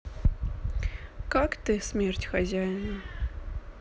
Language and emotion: Russian, sad